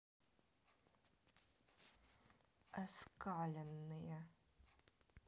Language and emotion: Russian, neutral